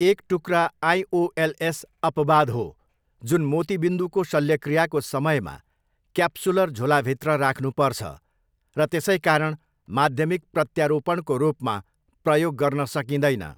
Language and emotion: Nepali, neutral